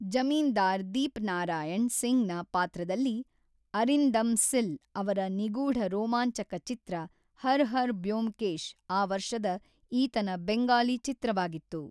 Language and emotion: Kannada, neutral